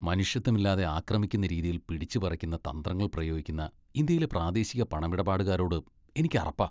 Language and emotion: Malayalam, disgusted